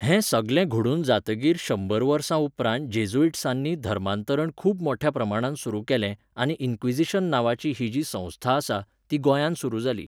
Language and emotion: Goan Konkani, neutral